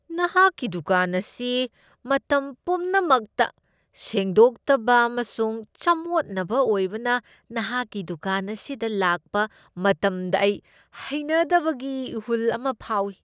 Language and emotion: Manipuri, disgusted